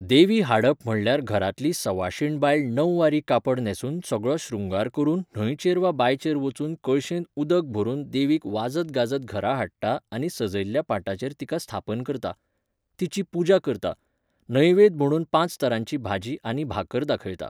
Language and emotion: Goan Konkani, neutral